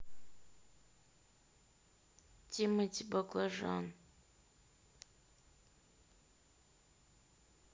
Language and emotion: Russian, neutral